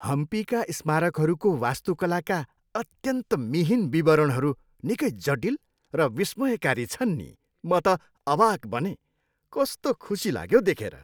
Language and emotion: Nepali, happy